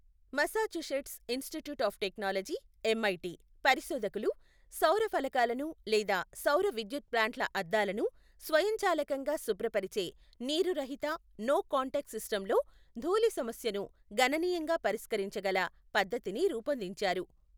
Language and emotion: Telugu, neutral